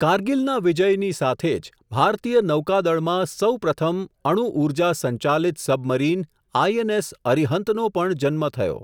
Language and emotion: Gujarati, neutral